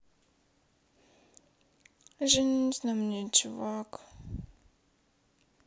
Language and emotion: Russian, sad